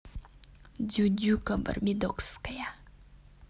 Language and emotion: Russian, neutral